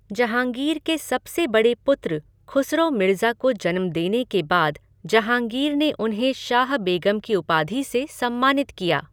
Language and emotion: Hindi, neutral